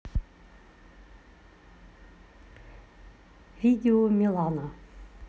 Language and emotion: Russian, neutral